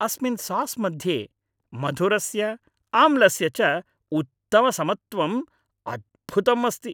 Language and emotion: Sanskrit, happy